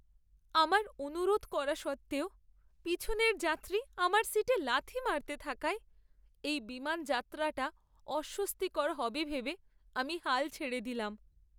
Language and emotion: Bengali, sad